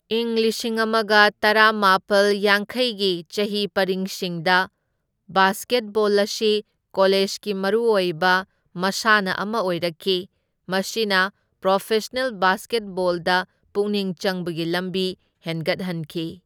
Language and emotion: Manipuri, neutral